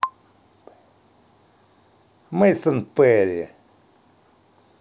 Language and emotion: Russian, positive